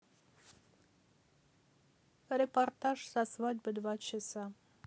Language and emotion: Russian, neutral